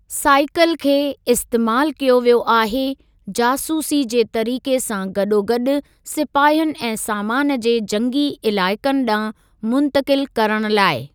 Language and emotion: Sindhi, neutral